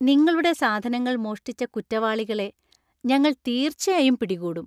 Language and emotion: Malayalam, happy